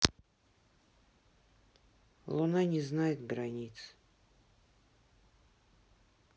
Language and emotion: Russian, sad